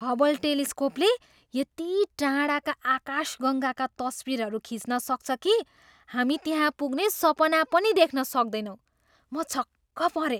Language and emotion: Nepali, surprised